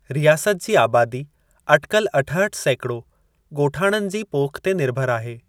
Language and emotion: Sindhi, neutral